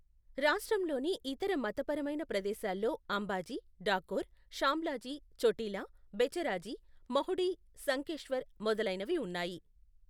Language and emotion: Telugu, neutral